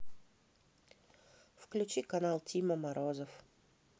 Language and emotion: Russian, neutral